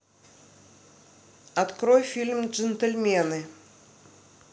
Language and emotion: Russian, neutral